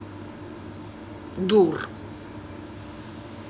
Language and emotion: Russian, angry